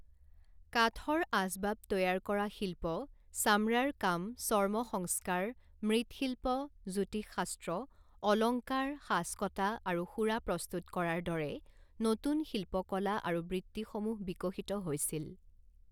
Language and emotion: Assamese, neutral